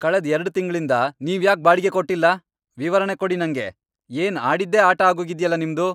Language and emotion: Kannada, angry